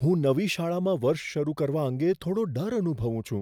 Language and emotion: Gujarati, fearful